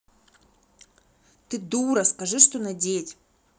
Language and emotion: Russian, angry